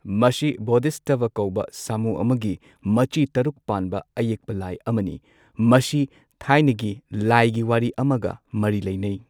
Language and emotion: Manipuri, neutral